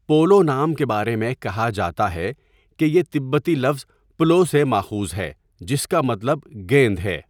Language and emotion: Urdu, neutral